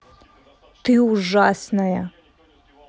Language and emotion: Russian, angry